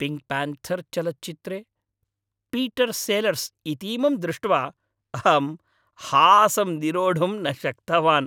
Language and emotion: Sanskrit, happy